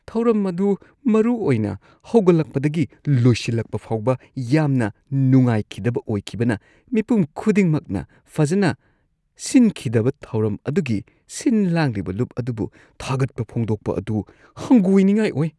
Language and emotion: Manipuri, disgusted